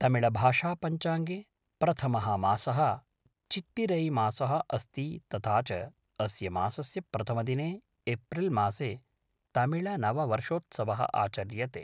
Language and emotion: Sanskrit, neutral